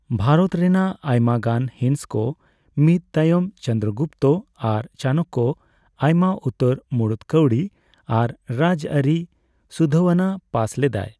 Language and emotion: Santali, neutral